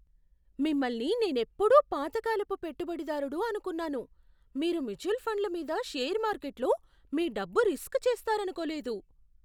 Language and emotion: Telugu, surprised